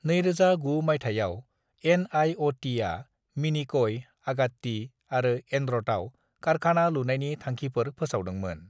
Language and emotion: Bodo, neutral